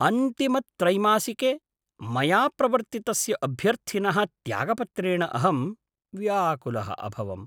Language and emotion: Sanskrit, surprised